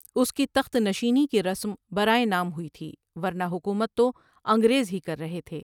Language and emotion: Urdu, neutral